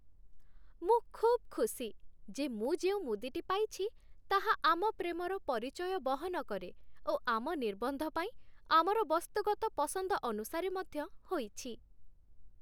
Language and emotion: Odia, happy